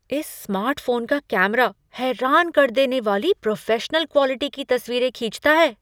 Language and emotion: Hindi, surprised